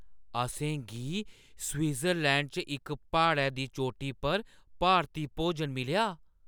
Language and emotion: Dogri, surprised